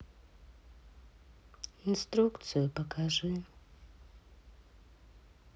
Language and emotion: Russian, sad